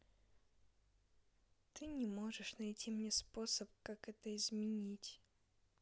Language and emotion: Russian, sad